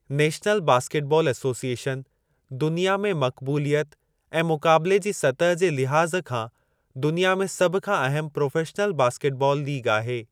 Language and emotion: Sindhi, neutral